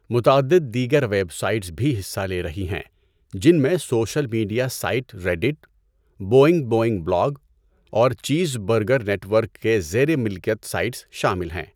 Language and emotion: Urdu, neutral